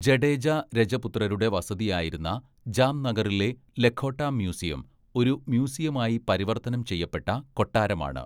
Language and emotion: Malayalam, neutral